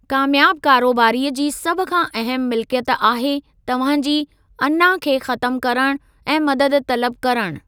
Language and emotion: Sindhi, neutral